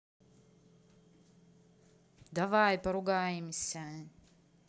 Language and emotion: Russian, neutral